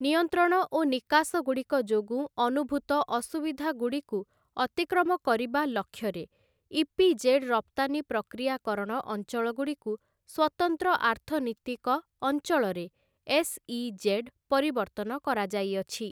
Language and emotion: Odia, neutral